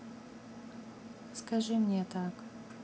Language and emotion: Russian, neutral